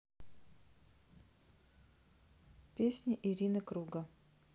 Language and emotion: Russian, sad